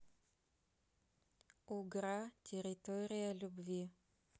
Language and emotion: Russian, neutral